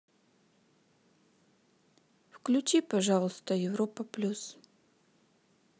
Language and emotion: Russian, neutral